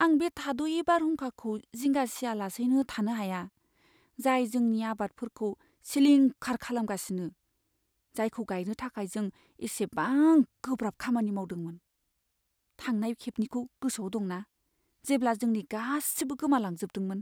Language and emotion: Bodo, fearful